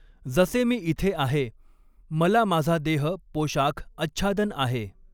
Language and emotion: Marathi, neutral